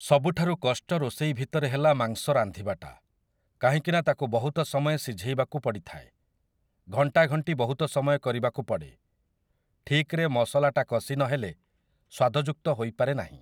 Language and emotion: Odia, neutral